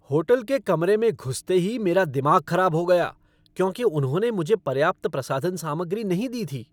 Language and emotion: Hindi, angry